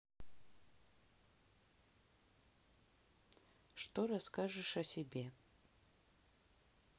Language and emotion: Russian, neutral